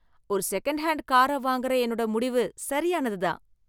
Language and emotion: Tamil, happy